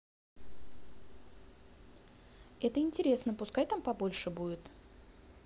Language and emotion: Russian, positive